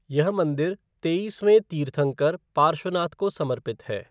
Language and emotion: Hindi, neutral